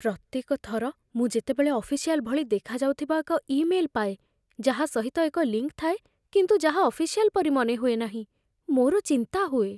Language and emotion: Odia, fearful